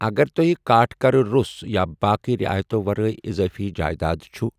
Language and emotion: Kashmiri, neutral